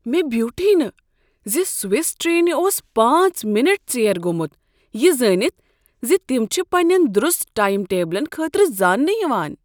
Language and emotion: Kashmiri, surprised